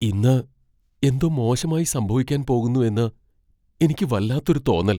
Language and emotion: Malayalam, fearful